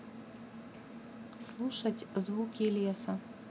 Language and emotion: Russian, neutral